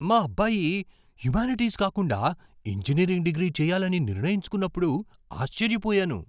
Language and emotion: Telugu, surprised